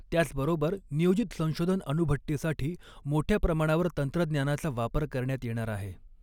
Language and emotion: Marathi, neutral